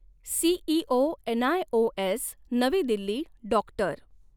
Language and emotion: Marathi, neutral